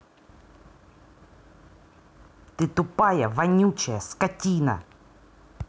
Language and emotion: Russian, angry